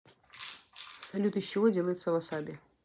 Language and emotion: Russian, neutral